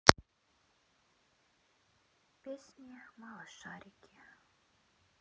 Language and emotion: Russian, sad